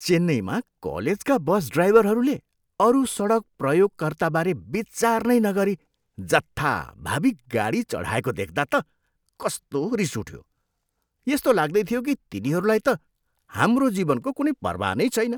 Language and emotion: Nepali, disgusted